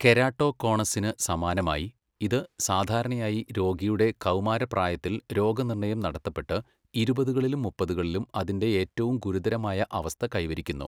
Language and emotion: Malayalam, neutral